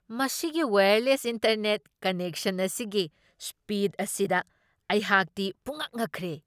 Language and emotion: Manipuri, surprised